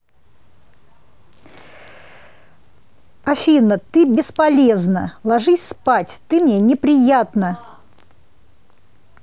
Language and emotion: Russian, angry